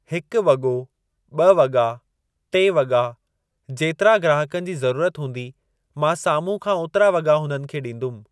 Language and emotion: Sindhi, neutral